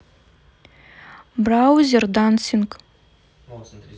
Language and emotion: Russian, neutral